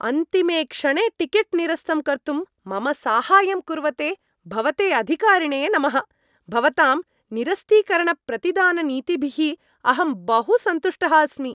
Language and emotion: Sanskrit, happy